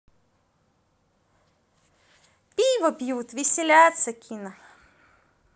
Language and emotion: Russian, positive